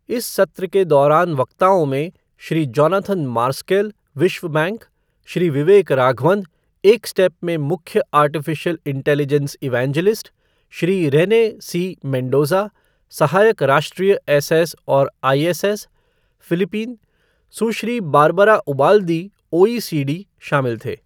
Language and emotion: Hindi, neutral